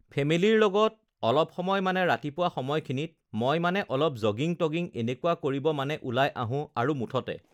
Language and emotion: Assamese, neutral